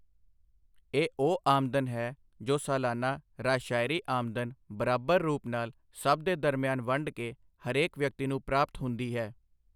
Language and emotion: Punjabi, neutral